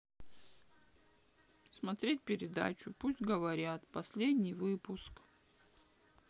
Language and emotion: Russian, sad